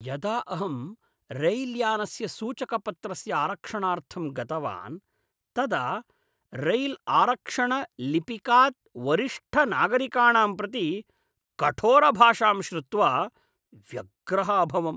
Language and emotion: Sanskrit, disgusted